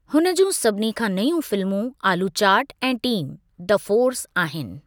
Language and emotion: Sindhi, neutral